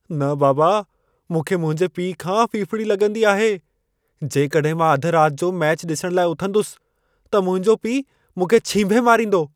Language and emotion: Sindhi, fearful